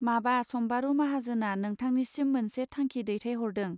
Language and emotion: Bodo, neutral